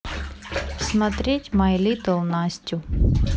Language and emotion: Russian, neutral